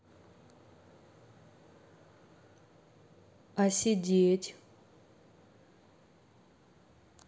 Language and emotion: Russian, neutral